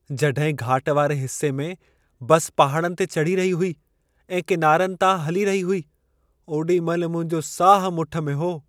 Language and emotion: Sindhi, fearful